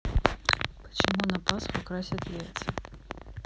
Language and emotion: Russian, neutral